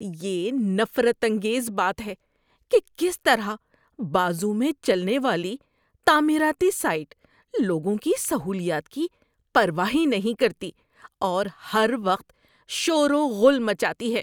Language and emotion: Urdu, disgusted